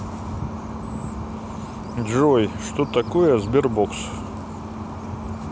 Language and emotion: Russian, neutral